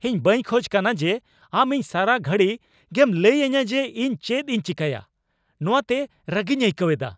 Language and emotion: Santali, angry